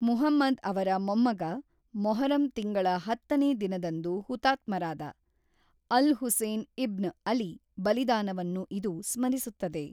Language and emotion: Kannada, neutral